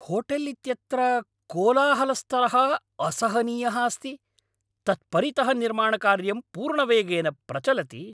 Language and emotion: Sanskrit, angry